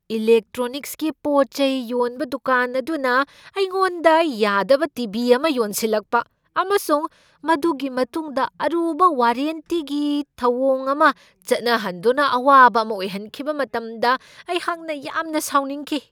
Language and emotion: Manipuri, angry